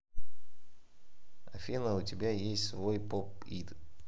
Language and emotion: Russian, neutral